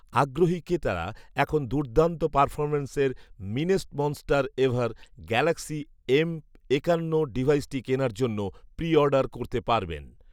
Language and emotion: Bengali, neutral